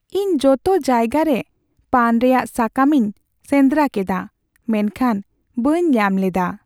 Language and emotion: Santali, sad